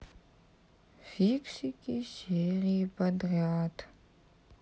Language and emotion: Russian, sad